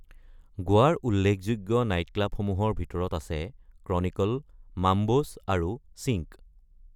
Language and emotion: Assamese, neutral